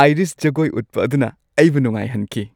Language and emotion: Manipuri, happy